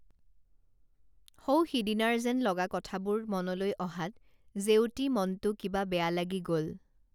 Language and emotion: Assamese, neutral